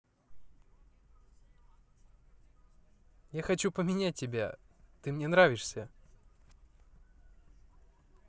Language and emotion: Russian, positive